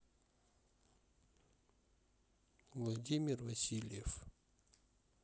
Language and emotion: Russian, neutral